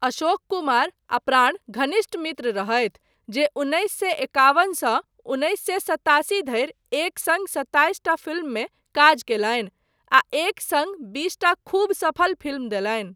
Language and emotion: Maithili, neutral